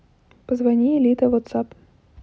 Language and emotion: Russian, neutral